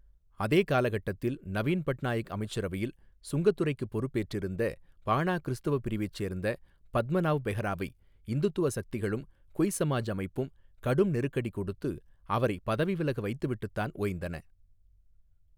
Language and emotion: Tamil, neutral